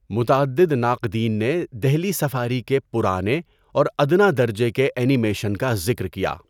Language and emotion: Urdu, neutral